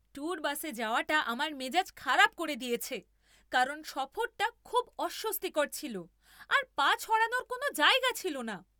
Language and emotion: Bengali, angry